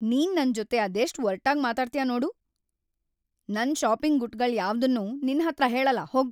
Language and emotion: Kannada, angry